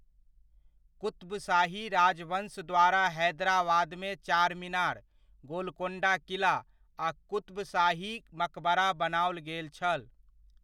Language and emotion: Maithili, neutral